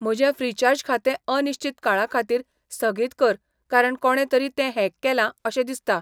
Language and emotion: Goan Konkani, neutral